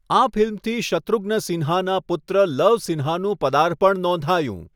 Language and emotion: Gujarati, neutral